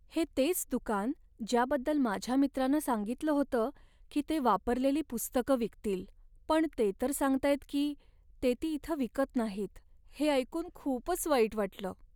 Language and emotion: Marathi, sad